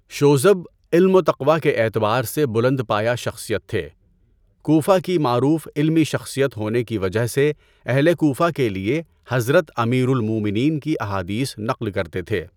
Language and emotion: Urdu, neutral